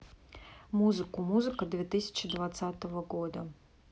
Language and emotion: Russian, neutral